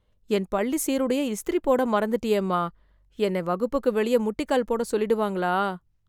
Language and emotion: Tamil, fearful